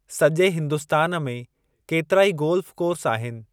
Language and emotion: Sindhi, neutral